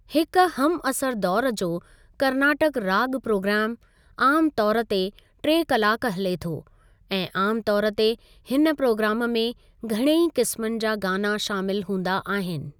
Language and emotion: Sindhi, neutral